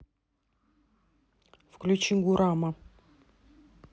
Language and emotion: Russian, neutral